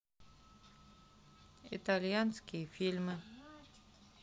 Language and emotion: Russian, neutral